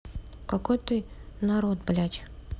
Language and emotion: Russian, neutral